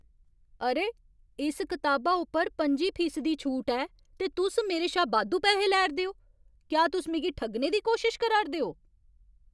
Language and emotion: Dogri, angry